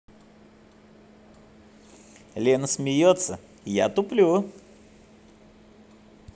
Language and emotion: Russian, positive